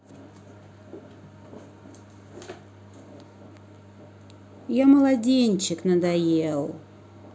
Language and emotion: Russian, neutral